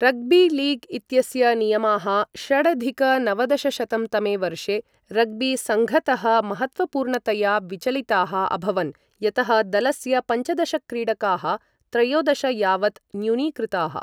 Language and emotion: Sanskrit, neutral